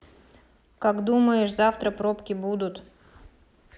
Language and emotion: Russian, neutral